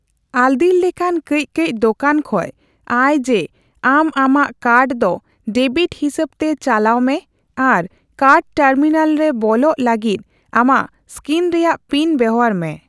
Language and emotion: Santali, neutral